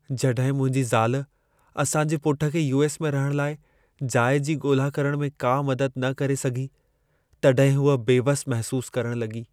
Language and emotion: Sindhi, sad